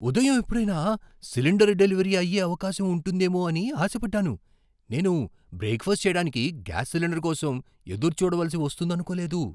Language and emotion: Telugu, surprised